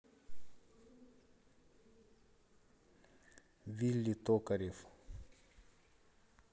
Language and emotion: Russian, neutral